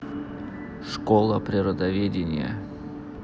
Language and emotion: Russian, neutral